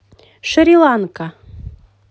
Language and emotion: Russian, positive